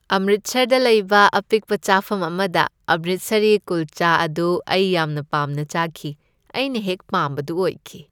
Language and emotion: Manipuri, happy